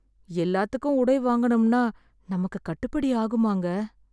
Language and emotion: Tamil, sad